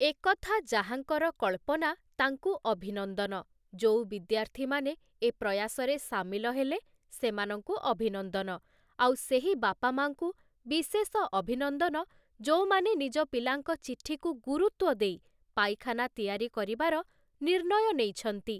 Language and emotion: Odia, neutral